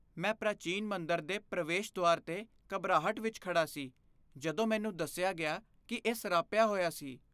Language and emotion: Punjabi, fearful